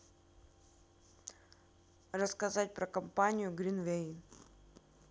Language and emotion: Russian, neutral